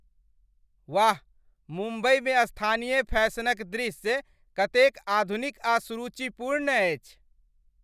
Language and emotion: Maithili, happy